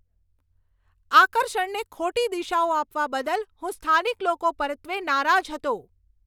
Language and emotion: Gujarati, angry